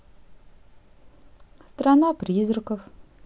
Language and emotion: Russian, neutral